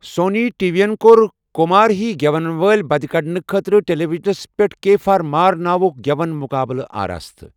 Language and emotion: Kashmiri, neutral